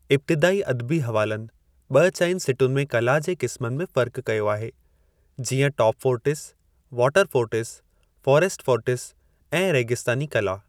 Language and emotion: Sindhi, neutral